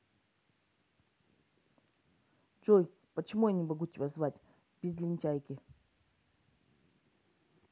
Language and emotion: Russian, neutral